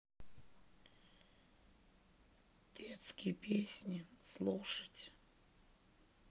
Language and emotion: Russian, sad